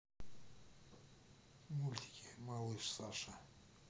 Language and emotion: Russian, neutral